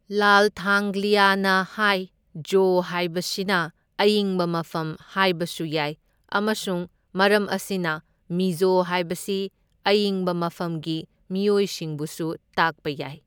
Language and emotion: Manipuri, neutral